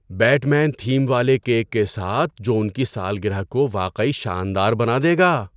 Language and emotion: Urdu, surprised